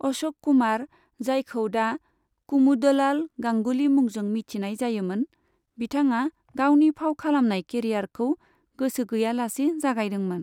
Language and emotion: Bodo, neutral